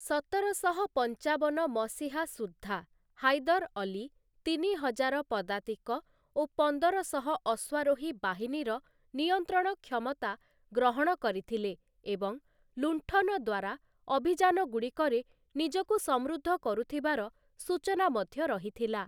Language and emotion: Odia, neutral